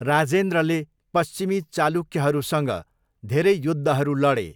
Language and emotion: Nepali, neutral